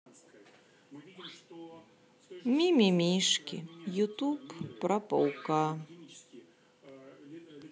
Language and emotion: Russian, sad